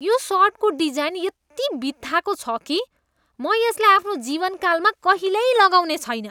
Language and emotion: Nepali, disgusted